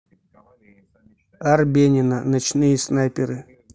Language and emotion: Russian, neutral